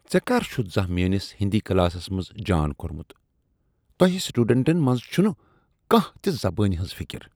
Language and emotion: Kashmiri, disgusted